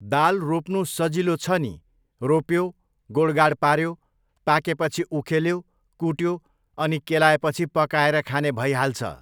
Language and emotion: Nepali, neutral